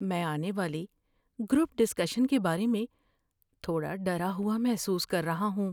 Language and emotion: Urdu, fearful